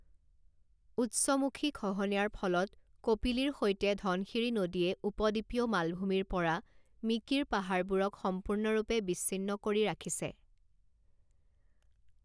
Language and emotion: Assamese, neutral